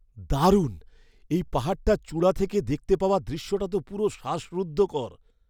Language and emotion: Bengali, surprised